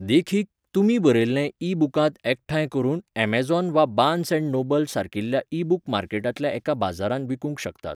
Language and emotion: Goan Konkani, neutral